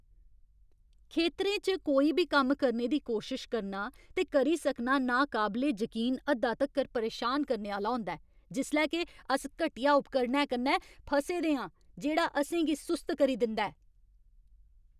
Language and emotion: Dogri, angry